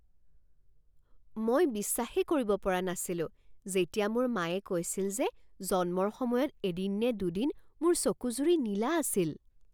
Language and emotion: Assamese, surprised